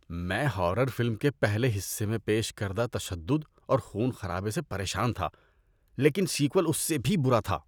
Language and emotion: Urdu, disgusted